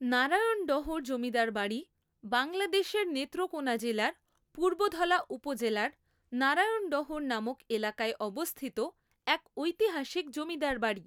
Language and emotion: Bengali, neutral